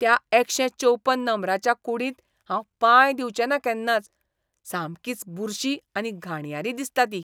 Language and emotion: Goan Konkani, disgusted